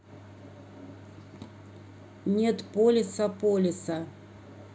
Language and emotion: Russian, neutral